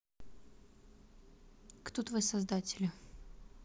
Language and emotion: Russian, neutral